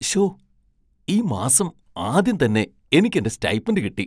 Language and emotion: Malayalam, surprised